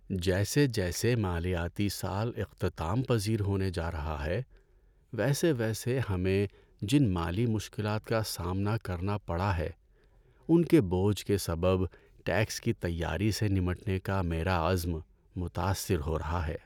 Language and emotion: Urdu, sad